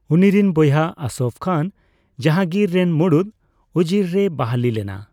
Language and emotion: Santali, neutral